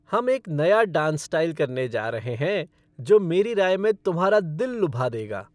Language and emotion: Hindi, happy